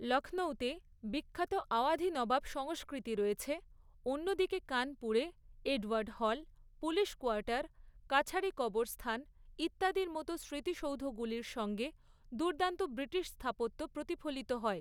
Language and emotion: Bengali, neutral